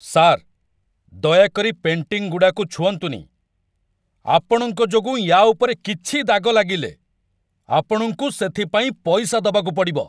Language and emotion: Odia, angry